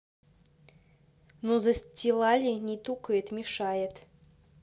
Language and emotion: Russian, neutral